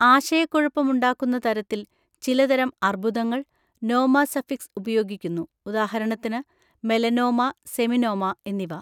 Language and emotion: Malayalam, neutral